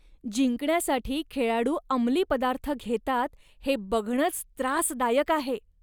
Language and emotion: Marathi, disgusted